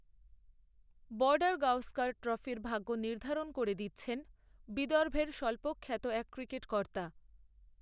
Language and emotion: Bengali, neutral